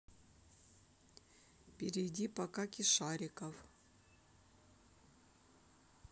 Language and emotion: Russian, neutral